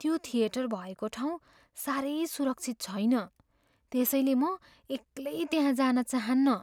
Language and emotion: Nepali, fearful